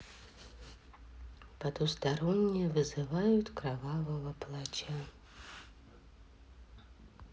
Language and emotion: Russian, sad